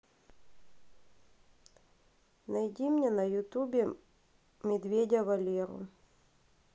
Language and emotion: Russian, neutral